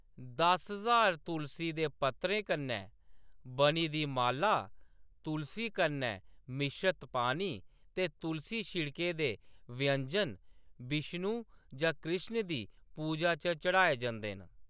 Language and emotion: Dogri, neutral